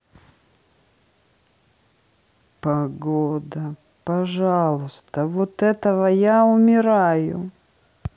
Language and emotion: Russian, sad